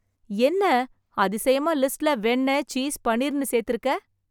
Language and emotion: Tamil, surprised